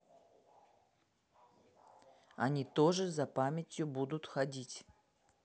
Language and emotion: Russian, neutral